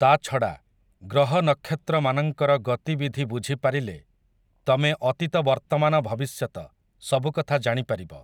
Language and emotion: Odia, neutral